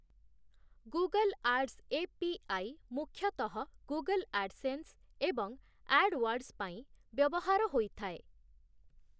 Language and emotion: Odia, neutral